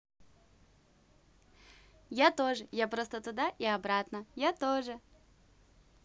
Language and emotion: Russian, positive